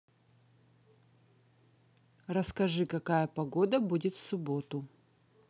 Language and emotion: Russian, neutral